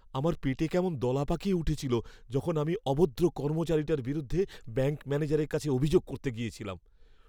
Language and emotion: Bengali, fearful